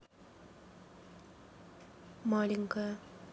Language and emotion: Russian, neutral